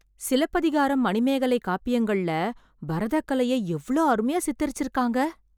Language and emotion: Tamil, surprised